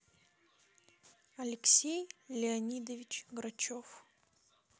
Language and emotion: Russian, neutral